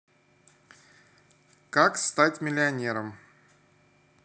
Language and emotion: Russian, neutral